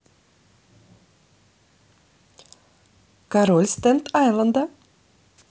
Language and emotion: Russian, positive